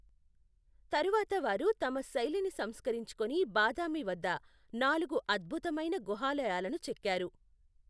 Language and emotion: Telugu, neutral